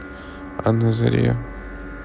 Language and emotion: Russian, neutral